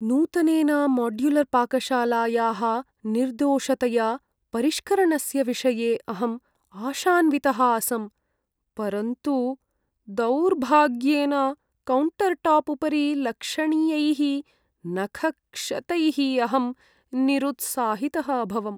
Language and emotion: Sanskrit, sad